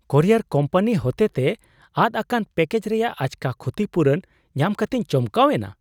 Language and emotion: Santali, surprised